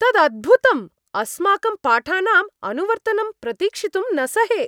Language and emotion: Sanskrit, happy